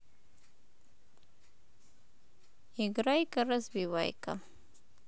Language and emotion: Russian, neutral